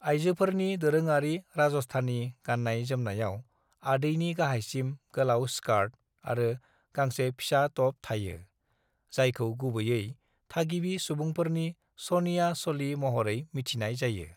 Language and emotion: Bodo, neutral